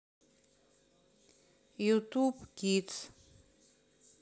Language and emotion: Russian, neutral